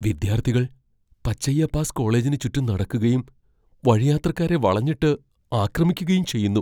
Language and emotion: Malayalam, fearful